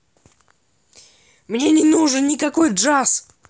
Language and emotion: Russian, angry